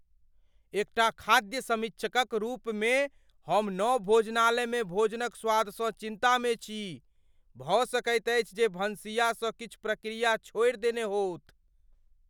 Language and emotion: Maithili, fearful